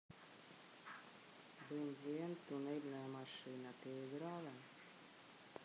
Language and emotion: Russian, neutral